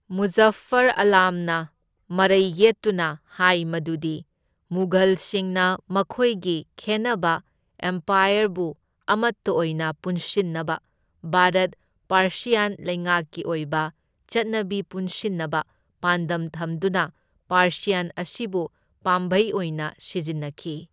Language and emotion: Manipuri, neutral